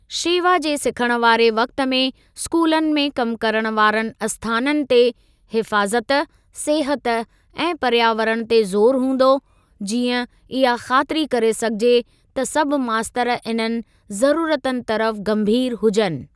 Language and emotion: Sindhi, neutral